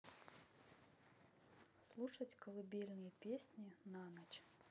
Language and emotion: Russian, neutral